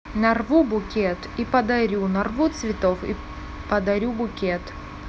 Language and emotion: Russian, neutral